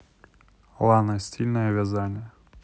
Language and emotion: Russian, neutral